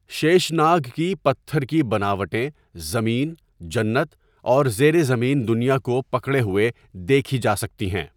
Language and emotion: Urdu, neutral